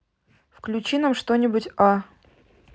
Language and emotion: Russian, neutral